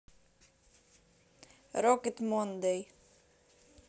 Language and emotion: Russian, neutral